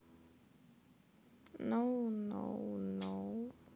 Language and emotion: Russian, sad